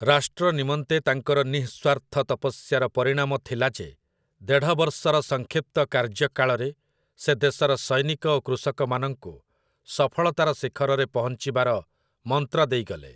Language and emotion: Odia, neutral